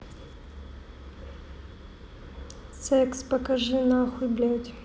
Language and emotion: Russian, neutral